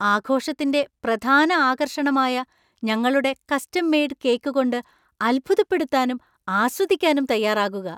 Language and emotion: Malayalam, surprised